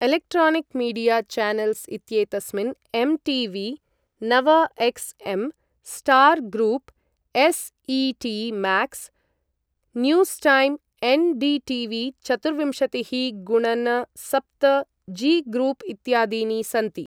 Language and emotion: Sanskrit, neutral